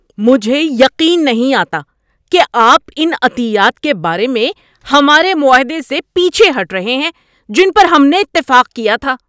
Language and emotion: Urdu, angry